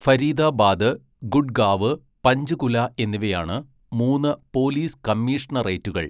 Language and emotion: Malayalam, neutral